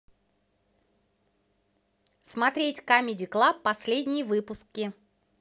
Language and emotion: Russian, positive